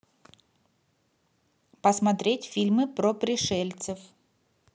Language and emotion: Russian, neutral